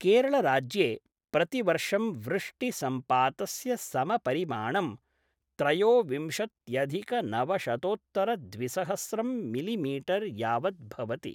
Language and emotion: Sanskrit, neutral